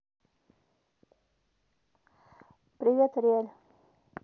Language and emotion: Russian, neutral